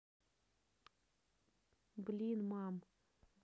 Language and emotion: Russian, neutral